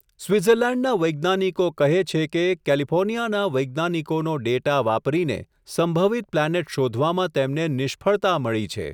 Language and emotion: Gujarati, neutral